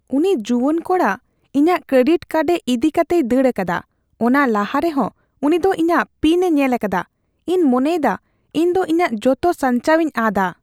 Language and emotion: Santali, fearful